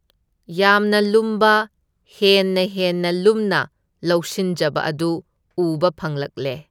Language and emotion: Manipuri, neutral